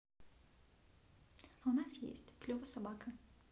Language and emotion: Russian, neutral